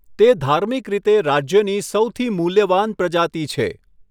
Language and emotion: Gujarati, neutral